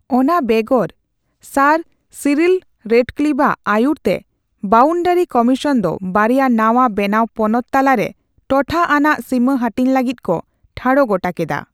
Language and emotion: Santali, neutral